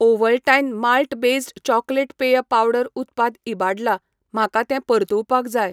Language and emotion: Goan Konkani, neutral